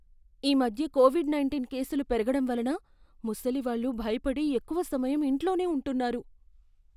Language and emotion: Telugu, fearful